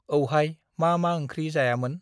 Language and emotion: Bodo, neutral